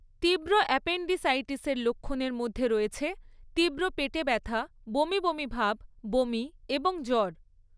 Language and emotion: Bengali, neutral